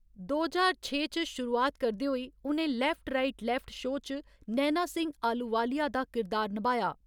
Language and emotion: Dogri, neutral